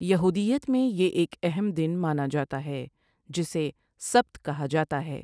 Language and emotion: Urdu, neutral